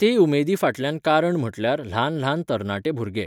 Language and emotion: Goan Konkani, neutral